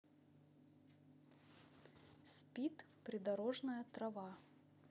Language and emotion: Russian, neutral